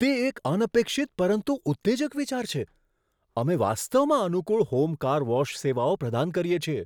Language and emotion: Gujarati, surprised